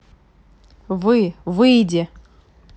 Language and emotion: Russian, neutral